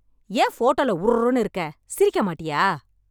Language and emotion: Tamil, angry